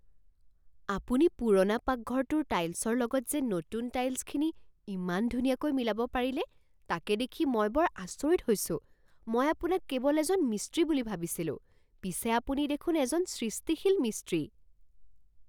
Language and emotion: Assamese, surprised